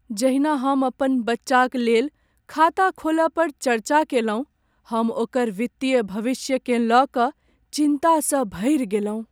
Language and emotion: Maithili, sad